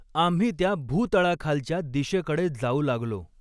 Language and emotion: Marathi, neutral